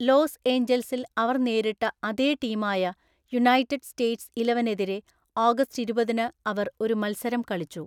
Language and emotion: Malayalam, neutral